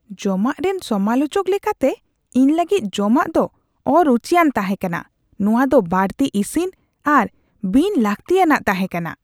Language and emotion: Santali, disgusted